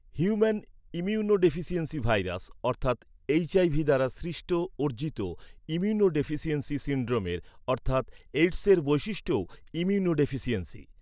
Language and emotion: Bengali, neutral